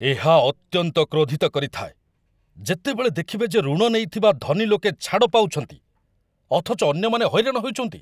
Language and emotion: Odia, angry